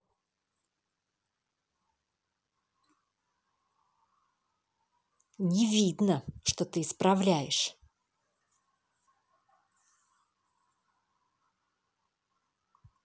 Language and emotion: Russian, angry